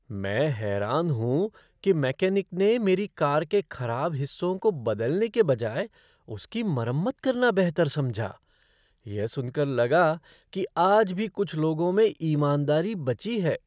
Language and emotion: Hindi, surprised